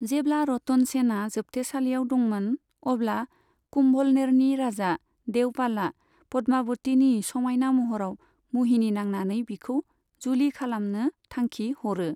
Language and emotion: Bodo, neutral